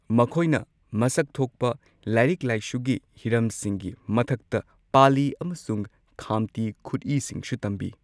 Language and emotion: Manipuri, neutral